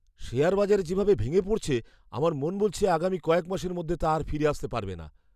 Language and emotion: Bengali, fearful